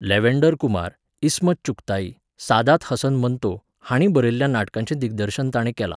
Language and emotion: Goan Konkani, neutral